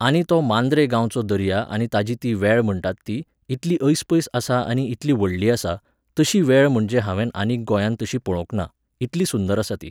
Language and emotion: Goan Konkani, neutral